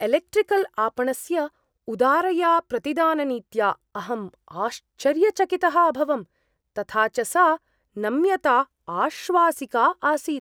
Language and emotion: Sanskrit, surprised